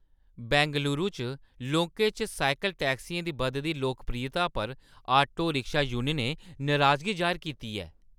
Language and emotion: Dogri, angry